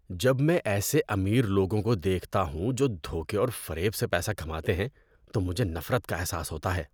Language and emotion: Urdu, disgusted